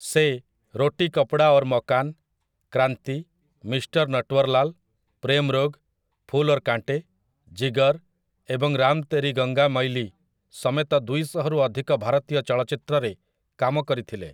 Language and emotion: Odia, neutral